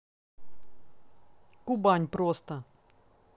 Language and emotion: Russian, neutral